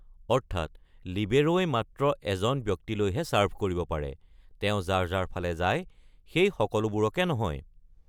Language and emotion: Assamese, neutral